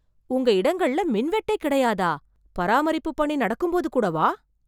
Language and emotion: Tamil, surprised